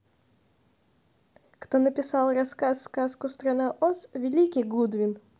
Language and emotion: Russian, neutral